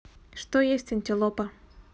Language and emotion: Russian, neutral